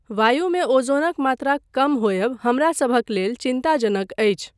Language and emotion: Maithili, neutral